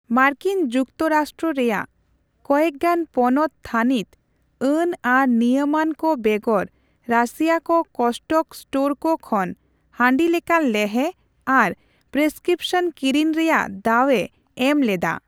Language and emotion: Santali, neutral